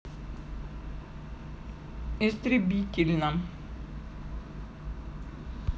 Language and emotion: Russian, neutral